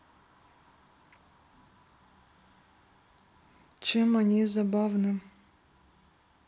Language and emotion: Russian, neutral